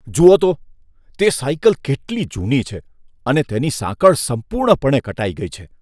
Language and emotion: Gujarati, disgusted